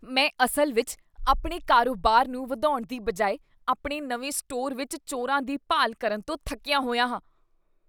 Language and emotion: Punjabi, disgusted